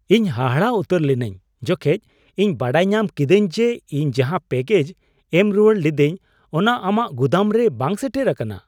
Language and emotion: Santali, surprised